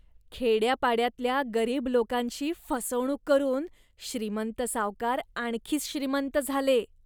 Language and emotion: Marathi, disgusted